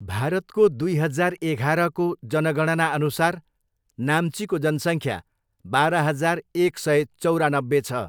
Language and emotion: Nepali, neutral